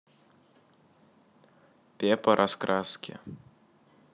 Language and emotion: Russian, neutral